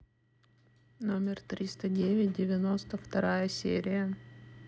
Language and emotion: Russian, neutral